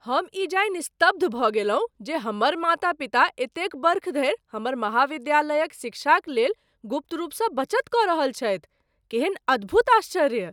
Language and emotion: Maithili, surprised